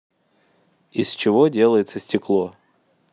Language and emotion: Russian, neutral